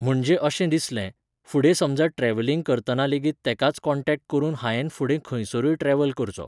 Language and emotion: Goan Konkani, neutral